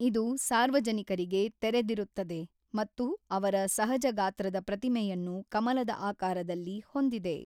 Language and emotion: Kannada, neutral